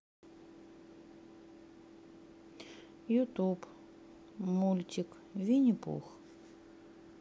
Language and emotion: Russian, sad